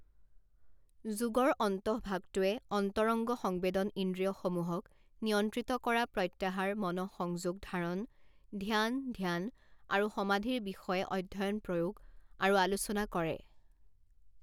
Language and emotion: Assamese, neutral